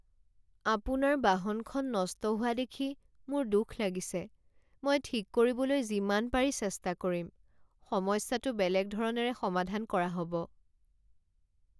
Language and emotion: Assamese, sad